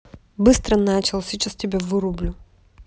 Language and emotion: Russian, angry